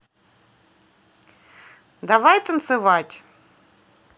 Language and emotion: Russian, positive